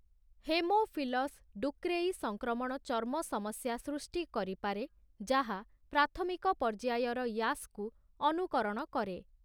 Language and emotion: Odia, neutral